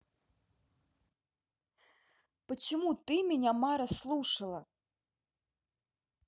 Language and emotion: Russian, angry